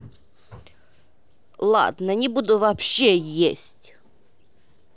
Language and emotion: Russian, angry